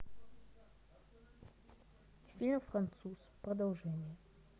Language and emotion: Russian, neutral